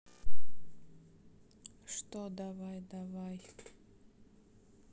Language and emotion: Russian, sad